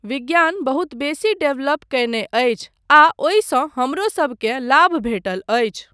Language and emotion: Maithili, neutral